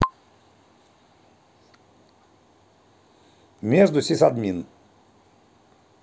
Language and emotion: Russian, neutral